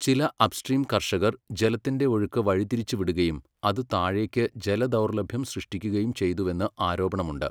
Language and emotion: Malayalam, neutral